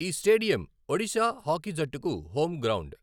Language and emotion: Telugu, neutral